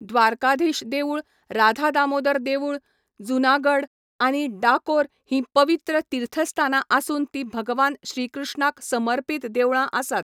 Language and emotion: Goan Konkani, neutral